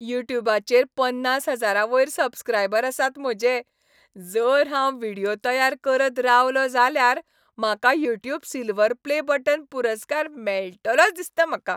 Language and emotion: Goan Konkani, happy